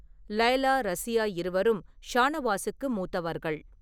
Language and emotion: Tamil, neutral